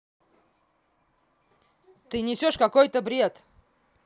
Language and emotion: Russian, angry